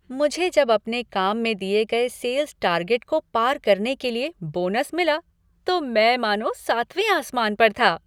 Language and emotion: Hindi, happy